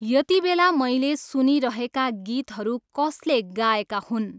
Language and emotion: Nepali, neutral